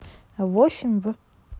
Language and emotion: Russian, neutral